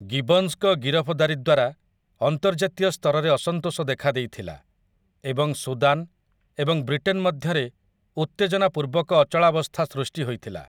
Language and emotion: Odia, neutral